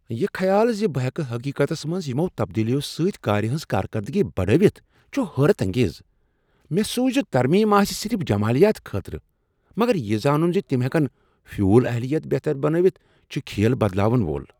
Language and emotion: Kashmiri, surprised